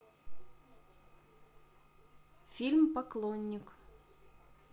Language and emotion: Russian, neutral